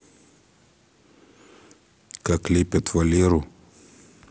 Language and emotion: Russian, neutral